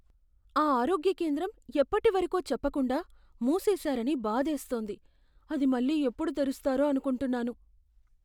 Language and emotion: Telugu, fearful